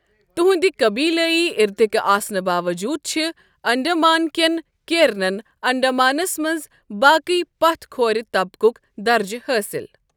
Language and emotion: Kashmiri, neutral